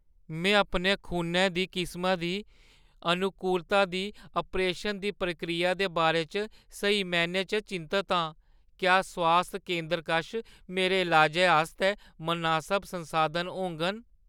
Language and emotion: Dogri, fearful